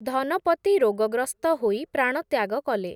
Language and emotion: Odia, neutral